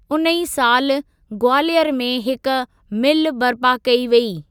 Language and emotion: Sindhi, neutral